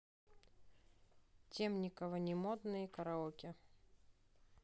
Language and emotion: Russian, neutral